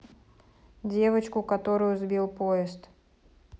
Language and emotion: Russian, neutral